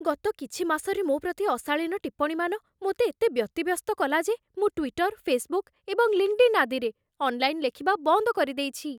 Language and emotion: Odia, fearful